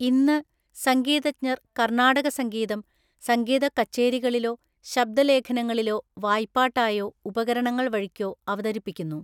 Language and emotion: Malayalam, neutral